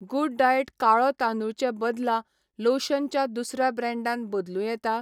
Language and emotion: Goan Konkani, neutral